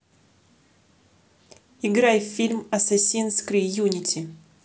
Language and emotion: Russian, neutral